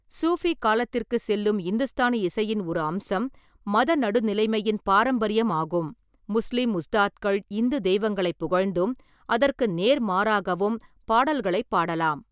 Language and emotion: Tamil, neutral